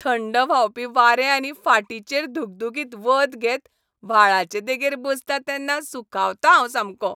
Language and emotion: Goan Konkani, happy